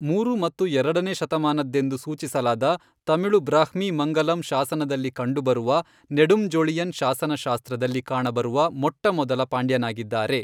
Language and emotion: Kannada, neutral